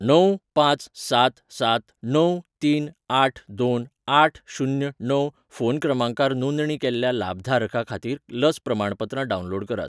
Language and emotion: Goan Konkani, neutral